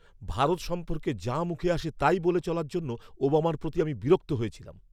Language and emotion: Bengali, angry